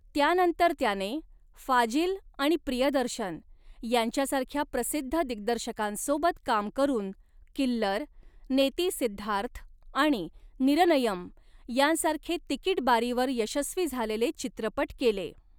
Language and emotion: Marathi, neutral